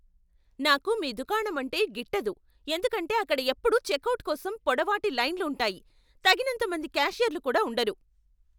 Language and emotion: Telugu, angry